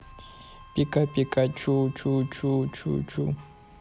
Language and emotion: Russian, neutral